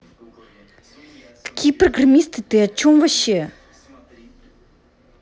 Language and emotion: Russian, angry